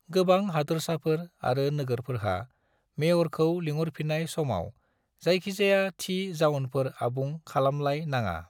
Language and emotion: Bodo, neutral